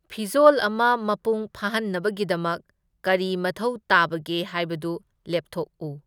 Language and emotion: Manipuri, neutral